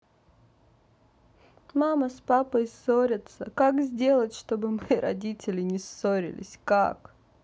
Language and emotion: Russian, sad